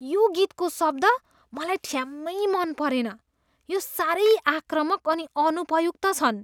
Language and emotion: Nepali, disgusted